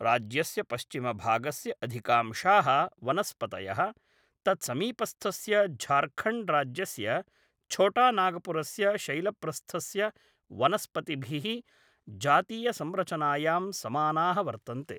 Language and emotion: Sanskrit, neutral